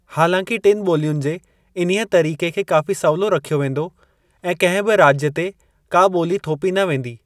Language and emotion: Sindhi, neutral